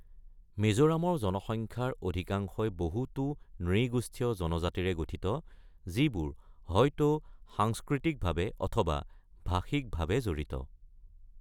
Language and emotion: Assamese, neutral